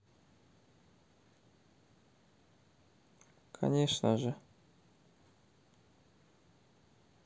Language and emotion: Russian, sad